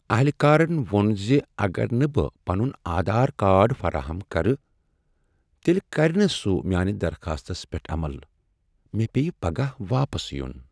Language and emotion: Kashmiri, sad